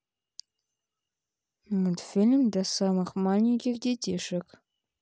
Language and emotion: Russian, neutral